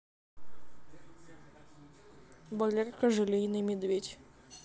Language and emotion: Russian, neutral